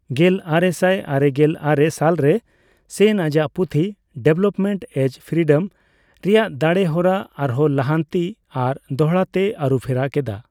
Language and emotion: Santali, neutral